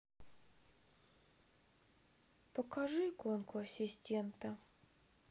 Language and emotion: Russian, sad